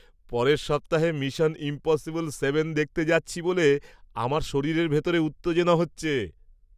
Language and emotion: Bengali, happy